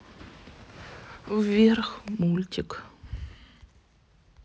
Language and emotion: Russian, sad